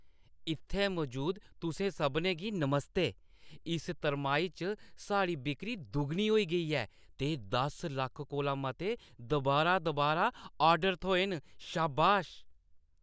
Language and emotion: Dogri, happy